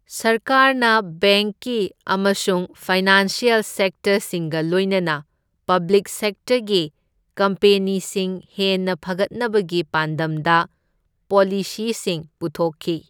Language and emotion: Manipuri, neutral